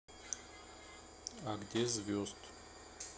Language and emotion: Russian, neutral